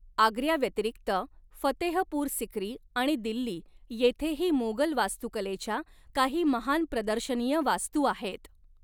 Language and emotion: Marathi, neutral